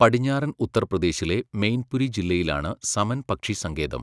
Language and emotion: Malayalam, neutral